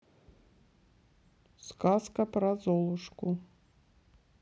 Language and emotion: Russian, neutral